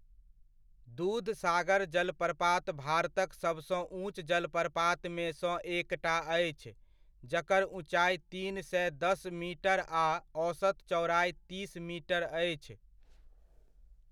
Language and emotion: Maithili, neutral